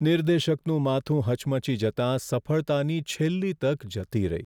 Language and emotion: Gujarati, sad